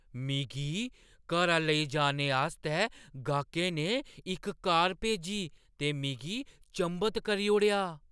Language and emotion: Dogri, surprised